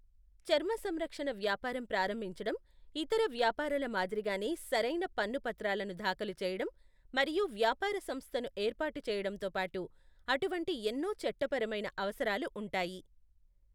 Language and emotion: Telugu, neutral